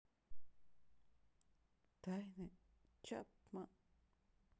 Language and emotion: Russian, sad